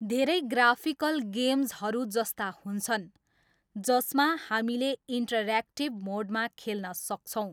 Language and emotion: Nepali, neutral